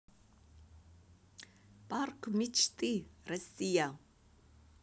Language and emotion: Russian, positive